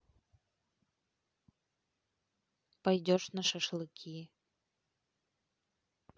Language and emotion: Russian, neutral